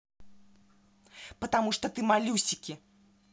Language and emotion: Russian, angry